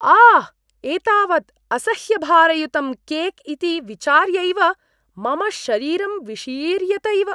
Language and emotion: Sanskrit, disgusted